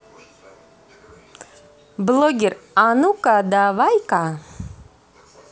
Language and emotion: Russian, positive